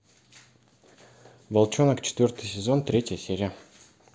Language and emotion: Russian, neutral